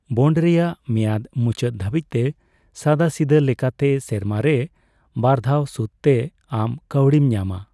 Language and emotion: Santali, neutral